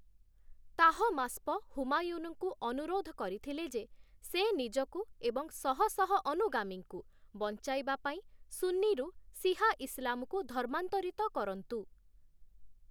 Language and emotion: Odia, neutral